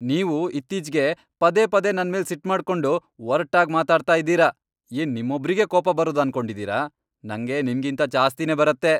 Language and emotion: Kannada, angry